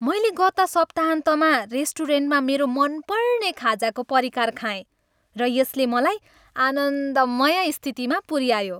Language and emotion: Nepali, happy